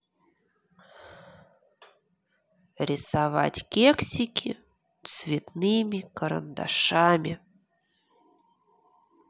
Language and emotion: Russian, neutral